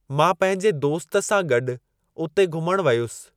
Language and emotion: Sindhi, neutral